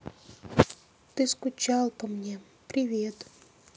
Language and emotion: Russian, sad